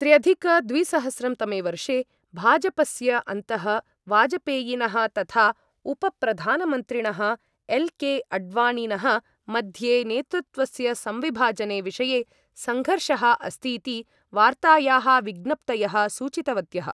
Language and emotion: Sanskrit, neutral